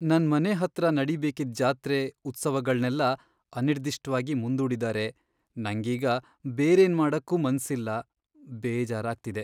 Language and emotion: Kannada, sad